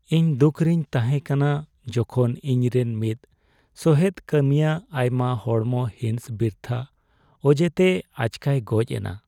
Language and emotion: Santali, sad